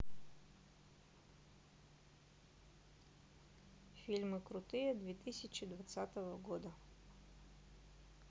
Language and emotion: Russian, neutral